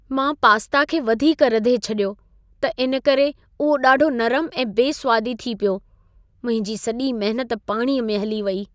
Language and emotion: Sindhi, sad